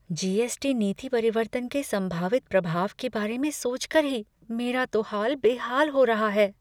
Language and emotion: Hindi, fearful